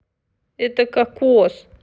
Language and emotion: Russian, neutral